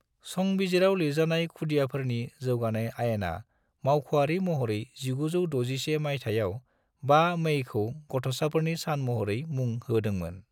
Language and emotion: Bodo, neutral